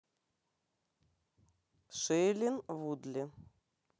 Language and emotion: Russian, neutral